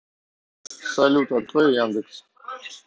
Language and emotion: Russian, neutral